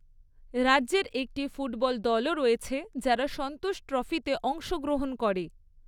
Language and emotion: Bengali, neutral